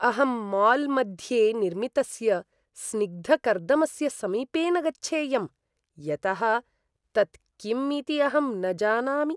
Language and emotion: Sanskrit, disgusted